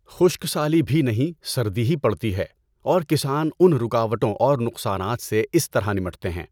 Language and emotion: Urdu, neutral